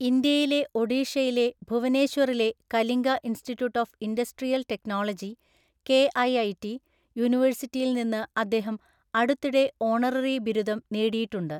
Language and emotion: Malayalam, neutral